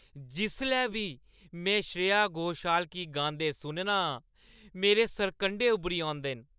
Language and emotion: Dogri, happy